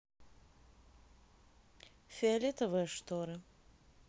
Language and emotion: Russian, neutral